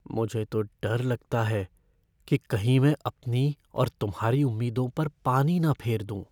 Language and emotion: Hindi, fearful